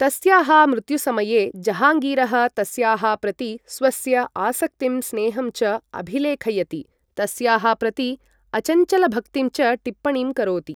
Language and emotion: Sanskrit, neutral